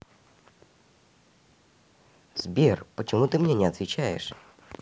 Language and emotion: Russian, neutral